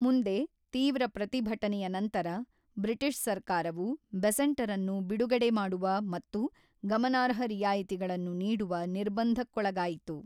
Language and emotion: Kannada, neutral